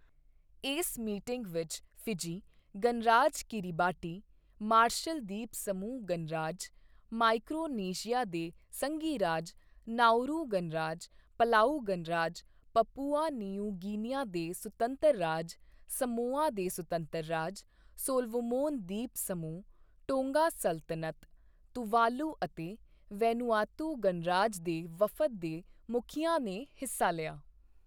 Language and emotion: Punjabi, neutral